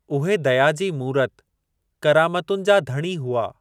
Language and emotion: Sindhi, neutral